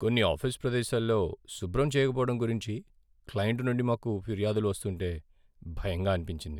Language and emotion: Telugu, sad